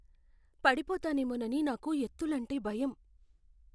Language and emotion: Telugu, fearful